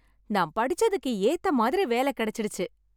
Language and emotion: Tamil, happy